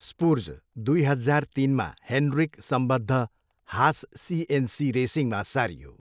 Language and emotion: Nepali, neutral